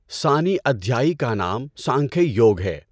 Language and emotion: Urdu, neutral